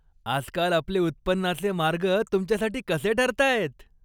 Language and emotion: Marathi, happy